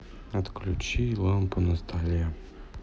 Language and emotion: Russian, sad